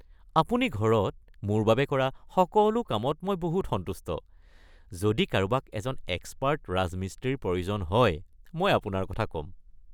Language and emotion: Assamese, happy